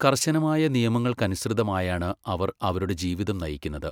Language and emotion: Malayalam, neutral